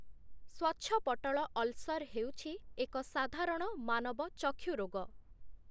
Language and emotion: Odia, neutral